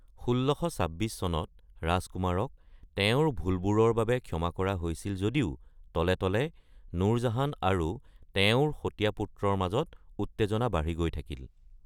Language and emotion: Assamese, neutral